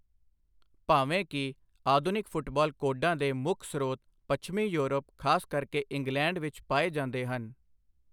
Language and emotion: Punjabi, neutral